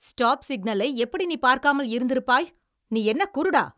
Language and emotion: Tamil, angry